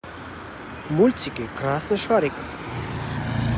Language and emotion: Russian, positive